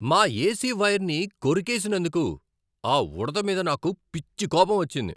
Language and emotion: Telugu, angry